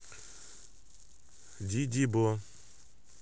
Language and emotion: Russian, neutral